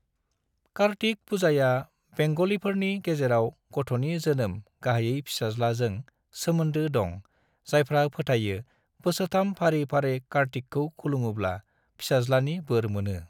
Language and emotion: Bodo, neutral